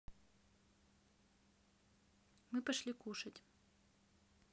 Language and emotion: Russian, neutral